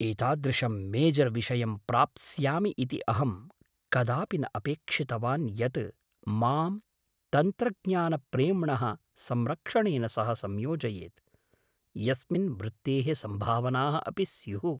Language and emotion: Sanskrit, surprised